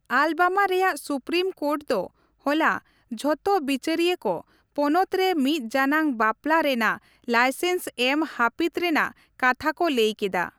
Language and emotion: Santali, neutral